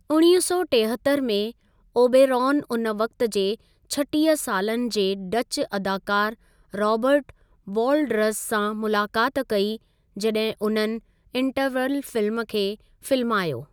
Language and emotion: Sindhi, neutral